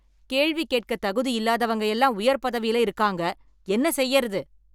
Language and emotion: Tamil, angry